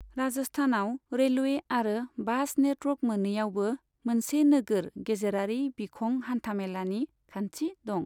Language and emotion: Bodo, neutral